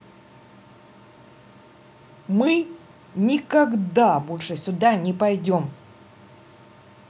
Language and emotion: Russian, angry